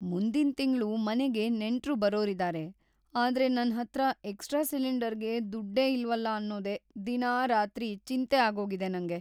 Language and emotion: Kannada, fearful